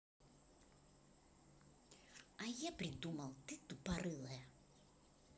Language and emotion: Russian, angry